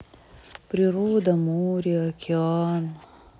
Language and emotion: Russian, sad